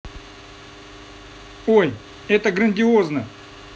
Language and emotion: Russian, positive